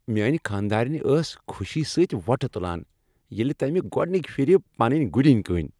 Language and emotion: Kashmiri, happy